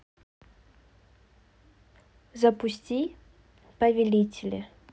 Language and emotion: Russian, neutral